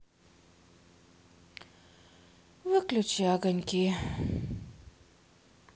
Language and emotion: Russian, sad